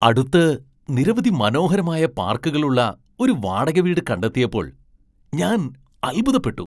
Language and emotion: Malayalam, surprised